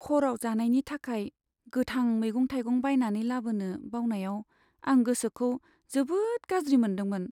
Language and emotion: Bodo, sad